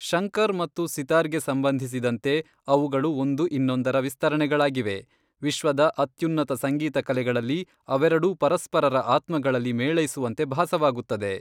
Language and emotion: Kannada, neutral